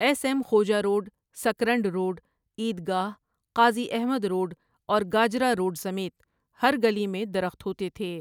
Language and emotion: Urdu, neutral